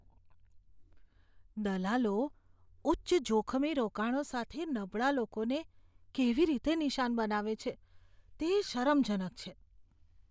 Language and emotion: Gujarati, disgusted